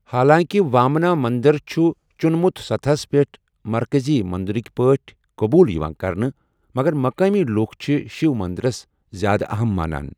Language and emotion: Kashmiri, neutral